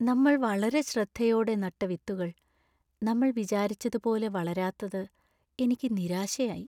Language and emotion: Malayalam, sad